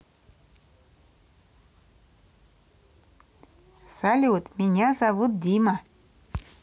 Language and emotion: Russian, positive